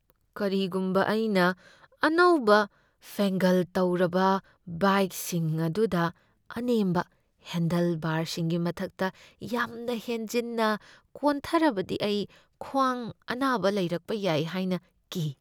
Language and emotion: Manipuri, fearful